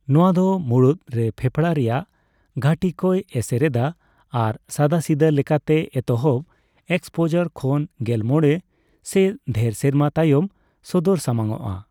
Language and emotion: Santali, neutral